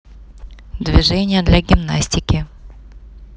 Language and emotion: Russian, neutral